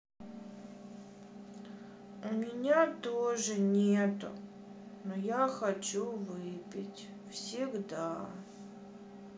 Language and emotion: Russian, sad